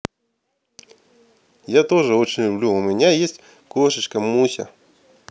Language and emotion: Russian, positive